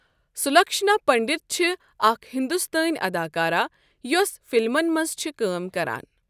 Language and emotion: Kashmiri, neutral